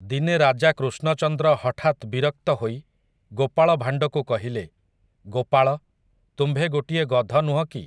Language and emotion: Odia, neutral